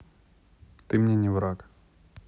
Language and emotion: Russian, neutral